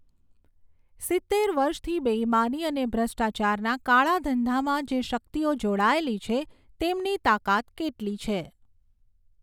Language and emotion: Gujarati, neutral